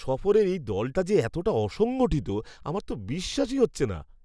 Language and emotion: Bengali, disgusted